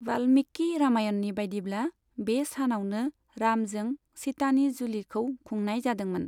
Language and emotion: Bodo, neutral